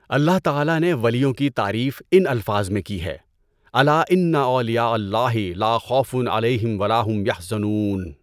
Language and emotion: Urdu, neutral